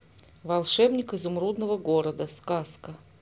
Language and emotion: Russian, neutral